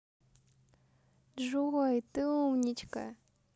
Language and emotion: Russian, positive